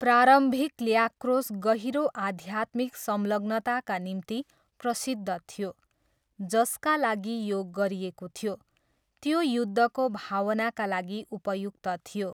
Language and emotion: Nepali, neutral